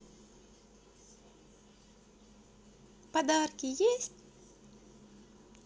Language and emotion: Russian, positive